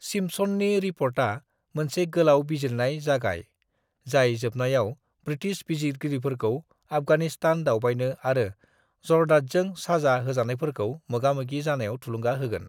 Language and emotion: Bodo, neutral